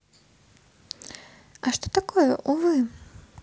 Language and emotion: Russian, neutral